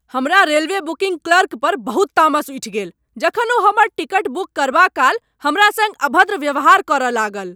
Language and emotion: Maithili, angry